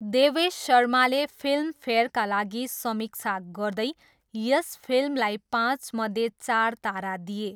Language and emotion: Nepali, neutral